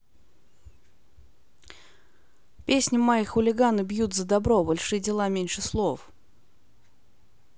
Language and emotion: Russian, neutral